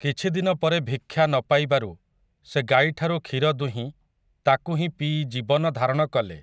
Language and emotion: Odia, neutral